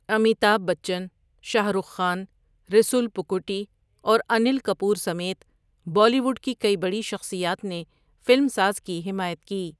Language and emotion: Urdu, neutral